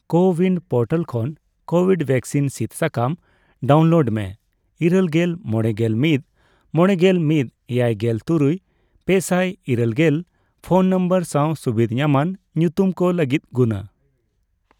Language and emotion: Santali, neutral